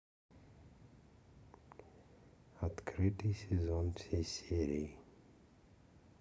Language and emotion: Russian, neutral